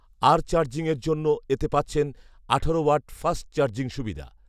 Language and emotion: Bengali, neutral